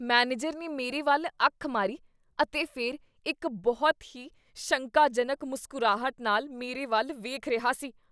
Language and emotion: Punjabi, disgusted